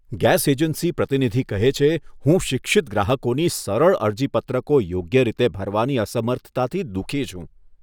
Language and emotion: Gujarati, disgusted